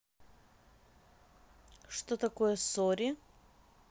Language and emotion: Russian, neutral